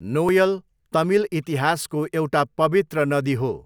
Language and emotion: Nepali, neutral